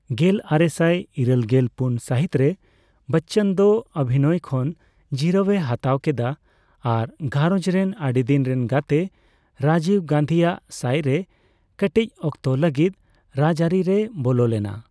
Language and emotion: Santali, neutral